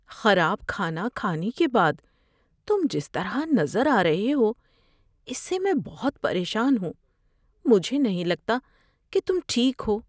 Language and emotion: Urdu, fearful